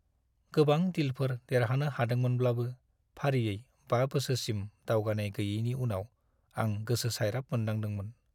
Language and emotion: Bodo, sad